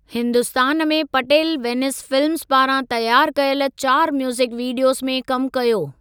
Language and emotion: Sindhi, neutral